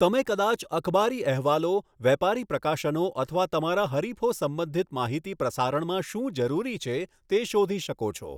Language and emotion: Gujarati, neutral